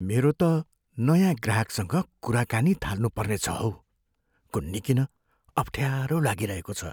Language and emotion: Nepali, fearful